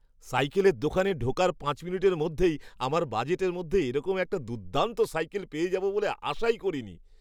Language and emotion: Bengali, surprised